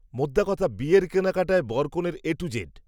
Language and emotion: Bengali, neutral